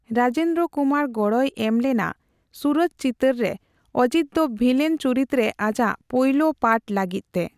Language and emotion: Santali, neutral